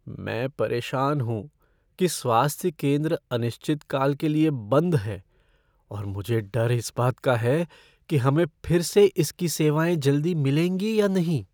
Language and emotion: Hindi, fearful